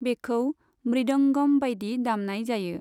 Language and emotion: Bodo, neutral